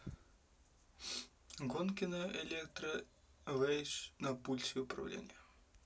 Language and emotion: Russian, neutral